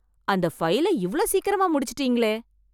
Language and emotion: Tamil, surprised